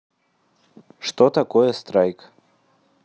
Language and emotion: Russian, neutral